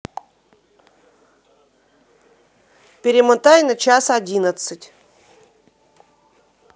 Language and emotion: Russian, neutral